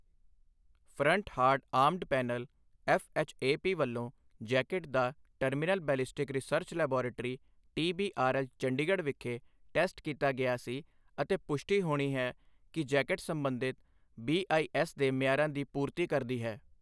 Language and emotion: Punjabi, neutral